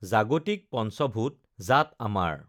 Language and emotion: Assamese, neutral